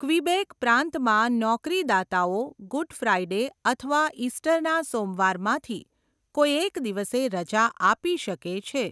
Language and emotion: Gujarati, neutral